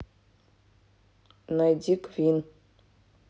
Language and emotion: Russian, neutral